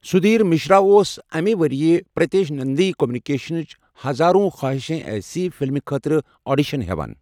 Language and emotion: Kashmiri, neutral